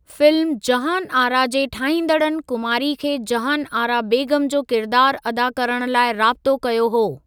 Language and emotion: Sindhi, neutral